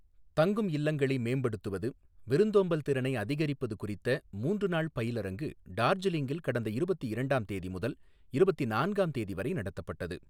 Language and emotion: Tamil, neutral